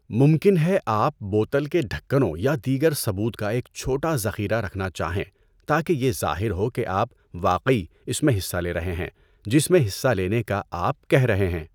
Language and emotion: Urdu, neutral